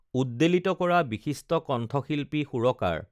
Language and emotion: Assamese, neutral